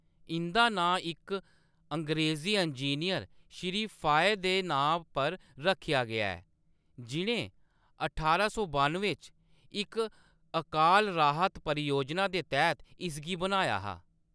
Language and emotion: Dogri, neutral